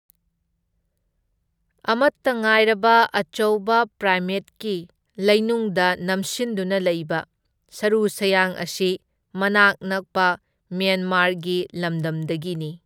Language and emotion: Manipuri, neutral